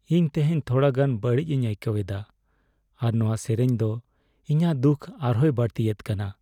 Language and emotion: Santali, sad